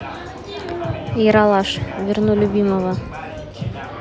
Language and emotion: Russian, neutral